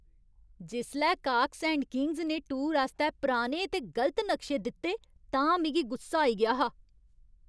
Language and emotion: Dogri, angry